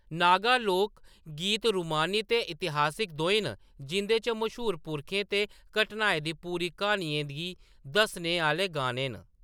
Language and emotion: Dogri, neutral